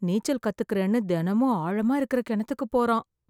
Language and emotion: Tamil, fearful